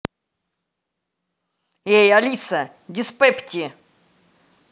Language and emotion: Russian, angry